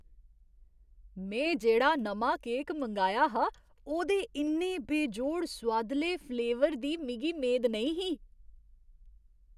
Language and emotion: Dogri, surprised